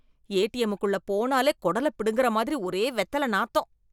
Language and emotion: Tamil, disgusted